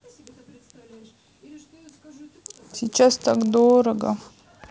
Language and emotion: Russian, sad